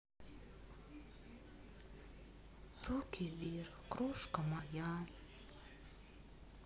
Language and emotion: Russian, sad